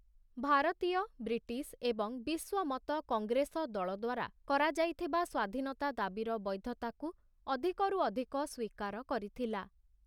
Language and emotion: Odia, neutral